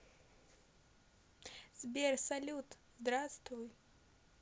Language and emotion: Russian, positive